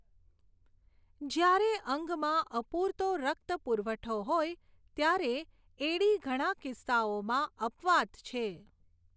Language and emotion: Gujarati, neutral